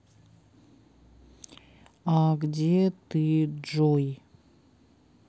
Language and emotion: Russian, neutral